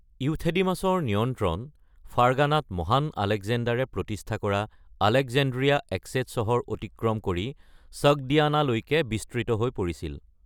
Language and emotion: Assamese, neutral